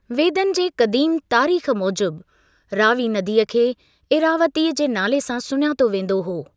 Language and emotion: Sindhi, neutral